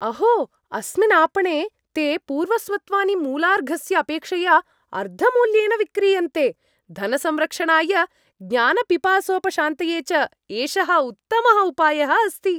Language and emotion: Sanskrit, happy